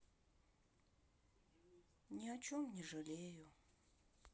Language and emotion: Russian, sad